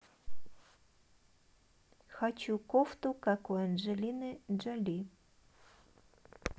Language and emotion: Russian, neutral